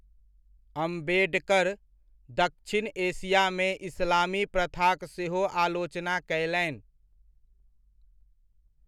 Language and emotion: Maithili, neutral